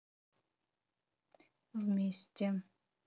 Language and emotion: Russian, neutral